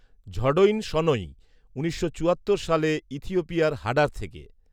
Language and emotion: Bengali, neutral